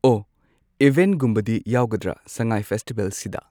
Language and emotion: Manipuri, neutral